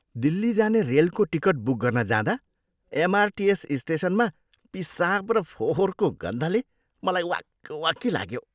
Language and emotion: Nepali, disgusted